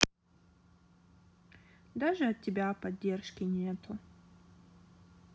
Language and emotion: Russian, sad